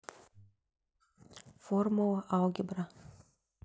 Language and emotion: Russian, neutral